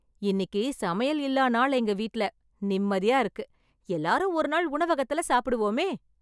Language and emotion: Tamil, happy